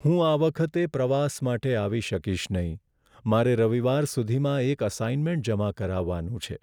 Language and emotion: Gujarati, sad